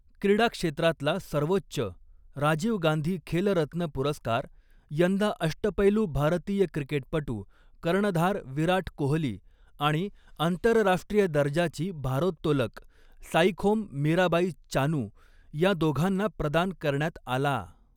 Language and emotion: Marathi, neutral